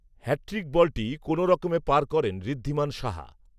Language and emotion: Bengali, neutral